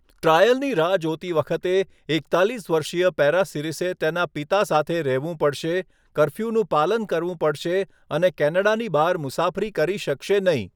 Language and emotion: Gujarati, neutral